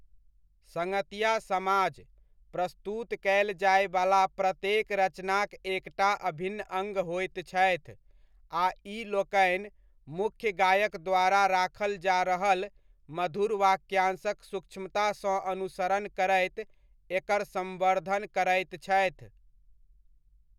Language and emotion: Maithili, neutral